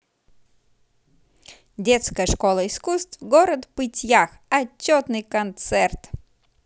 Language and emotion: Russian, positive